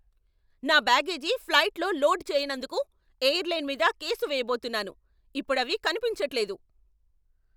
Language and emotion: Telugu, angry